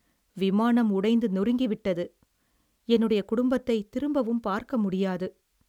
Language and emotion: Tamil, sad